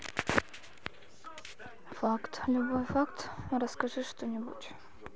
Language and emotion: Russian, sad